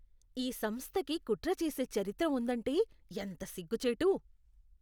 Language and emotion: Telugu, disgusted